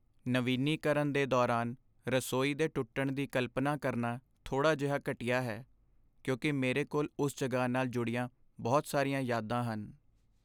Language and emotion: Punjabi, sad